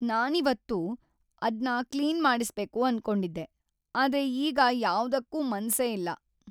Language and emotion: Kannada, sad